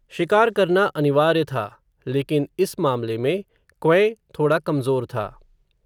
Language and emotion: Hindi, neutral